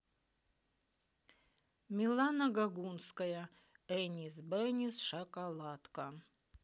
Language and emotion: Russian, neutral